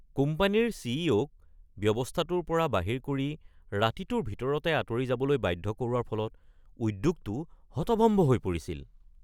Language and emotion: Assamese, surprised